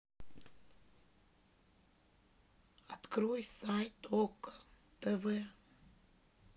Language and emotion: Russian, sad